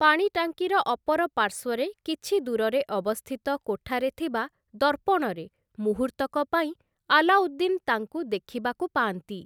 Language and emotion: Odia, neutral